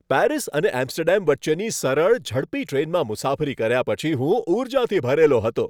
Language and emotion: Gujarati, happy